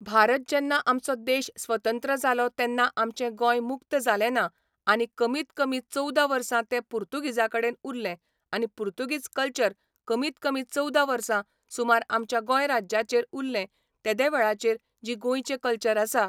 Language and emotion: Goan Konkani, neutral